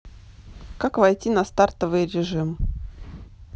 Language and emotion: Russian, neutral